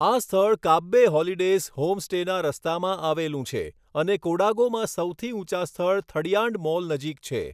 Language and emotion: Gujarati, neutral